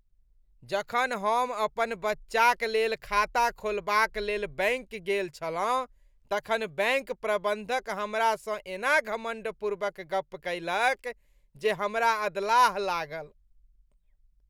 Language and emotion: Maithili, disgusted